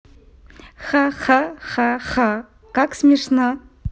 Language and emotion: Russian, positive